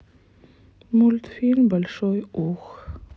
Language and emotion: Russian, sad